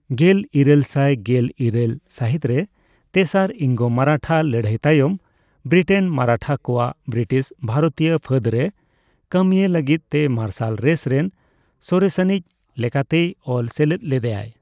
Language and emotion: Santali, neutral